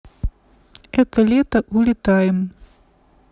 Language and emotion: Russian, neutral